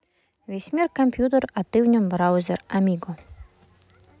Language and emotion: Russian, neutral